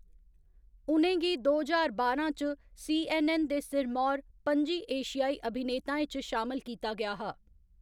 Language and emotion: Dogri, neutral